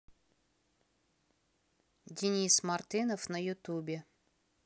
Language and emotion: Russian, neutral